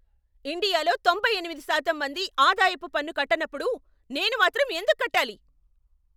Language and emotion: Telugu, angry